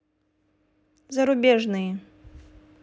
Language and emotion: Russian, neutral